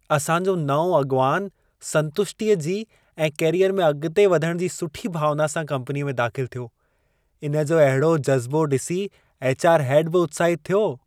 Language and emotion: Sindhi, happy